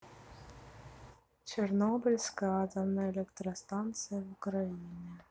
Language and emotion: Russian, neutral